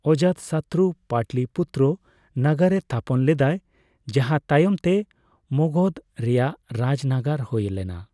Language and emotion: Santali, neutral